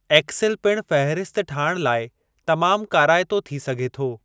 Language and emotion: Sindhi, neutral